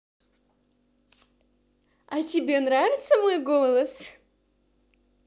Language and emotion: Russian, positive